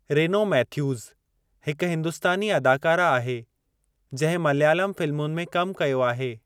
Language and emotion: Sindhi, neutral